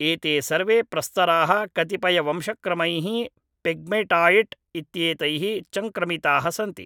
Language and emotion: Sanskrit, neutral